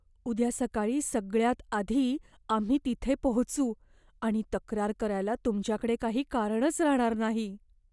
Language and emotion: Marathi, fearful